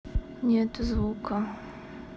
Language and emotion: Russian, sad